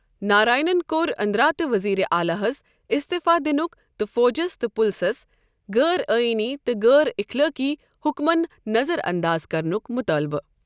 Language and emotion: Kashmiri, neutral